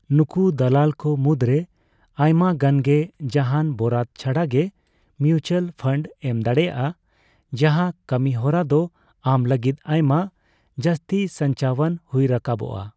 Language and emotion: Santali, neutral